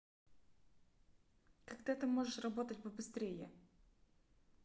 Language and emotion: Russian, angry